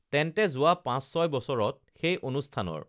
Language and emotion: Assamese, neutral